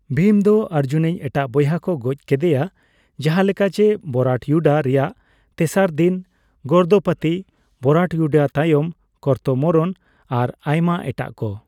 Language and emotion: Santali, neutral